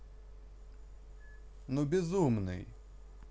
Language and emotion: Russian, neutral